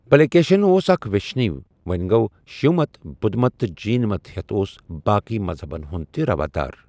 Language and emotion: Kashmiri, neutral